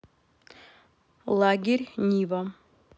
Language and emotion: Russian, neutral